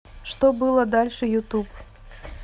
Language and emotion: Russian, neutral